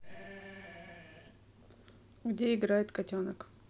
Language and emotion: Russian, neutral